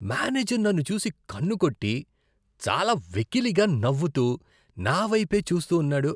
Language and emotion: Telugu, disgusted